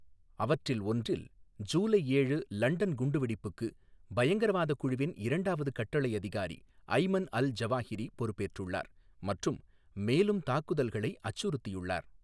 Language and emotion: Tamil, neutral